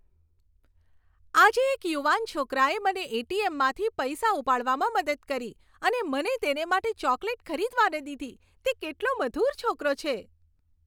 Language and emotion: Gujarati, happy